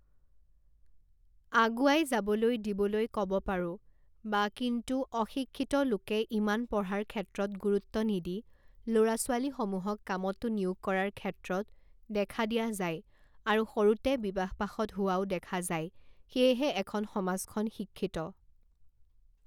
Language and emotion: Assamese, neutral